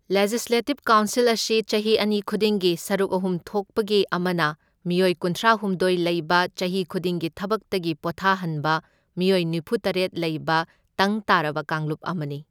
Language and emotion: Manipuri, neutral